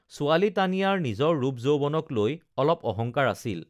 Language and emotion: Assamese, neutral